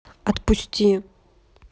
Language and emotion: Russian, neutral